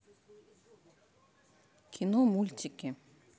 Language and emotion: Russian, neutral